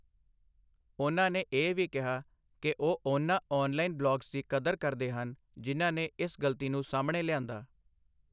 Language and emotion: Punjabi, neutral